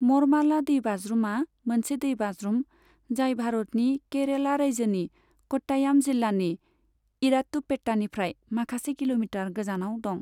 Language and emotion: Bodo, neutral